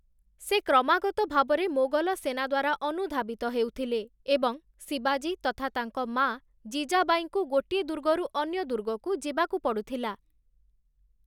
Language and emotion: Odia, neutral